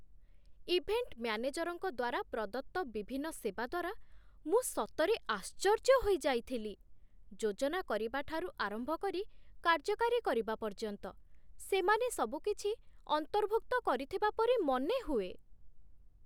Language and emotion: Odia, surprised